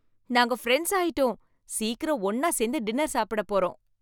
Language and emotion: Tamil, happy